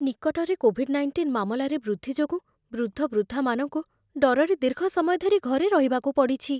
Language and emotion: Odia, fearful